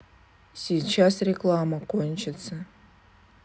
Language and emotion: Russian, neutral